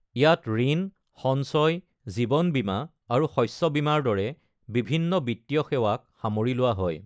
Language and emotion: Assamese, neutral